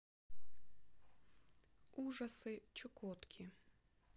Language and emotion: Russian, neutral